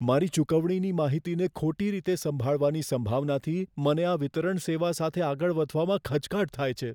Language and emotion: Gujarati, fearful